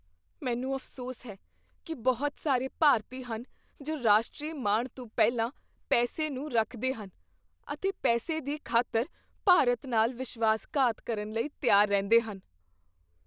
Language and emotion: Punjabi, fearful